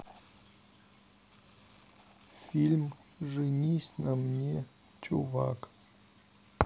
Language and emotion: Russian, sad